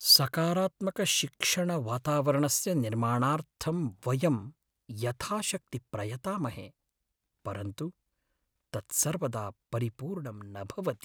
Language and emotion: Sanskrit, sad